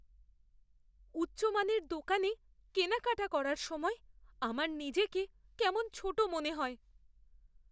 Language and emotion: Bengali, fearful